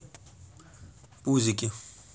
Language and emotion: Russian, neutral